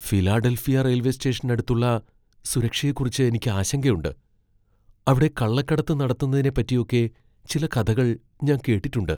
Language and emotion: Malayalam, fearful